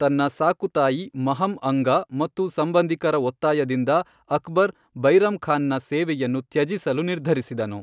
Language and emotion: Kannada, neutral